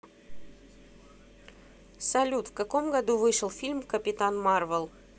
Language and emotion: Russian, neutral